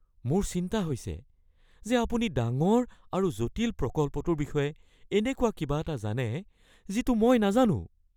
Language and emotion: Assamese, fearful